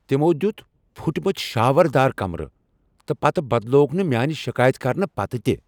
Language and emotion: Kashmiri, angry